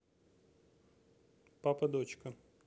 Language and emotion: Russian, neutral